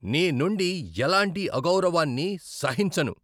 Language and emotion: Telugu, angry